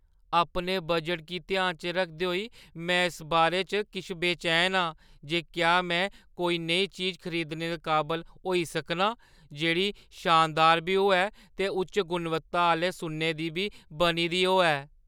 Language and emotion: Dogri, fearful